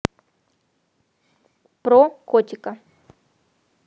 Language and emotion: Russian, neutral